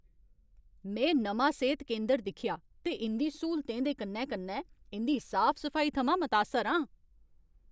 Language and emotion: Dogri, happy